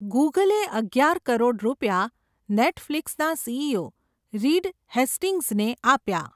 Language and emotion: Gujarati, neutral